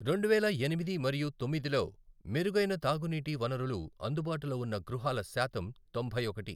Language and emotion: Telugu, neutral